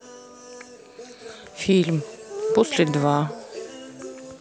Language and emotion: Russian, neutral